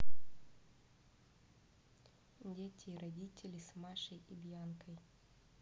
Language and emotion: Russian, neutral